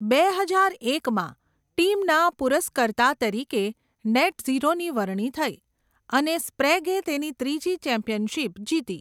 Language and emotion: Gujarati, neutral